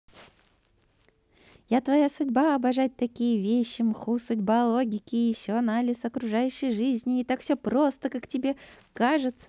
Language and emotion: Russian, positive